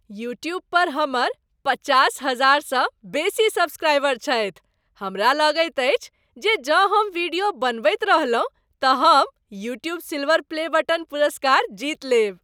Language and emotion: Maithili, happy